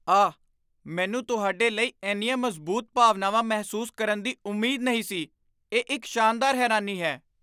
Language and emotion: Punjabi, surprised